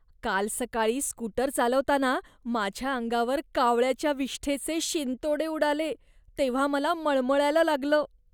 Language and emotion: Marathi, disgusted